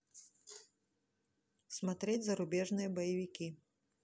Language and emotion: Russian, neutral